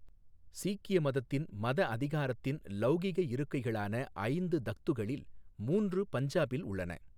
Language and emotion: Tamil, neutral